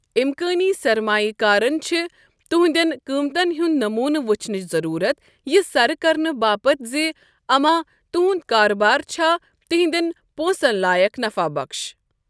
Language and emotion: Kashmiri, neutral